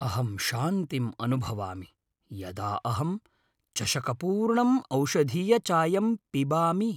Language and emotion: Sanskrit, happy